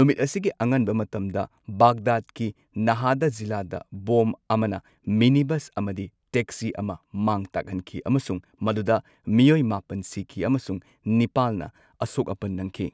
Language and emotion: Manipuri, neutral